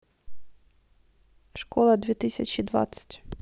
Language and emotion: Russian, neutral